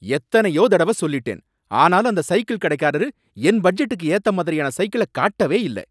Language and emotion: Tamil, angry